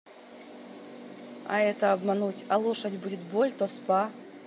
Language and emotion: Russian, neutral